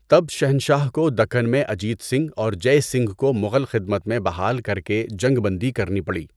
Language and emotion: Urdu, neutral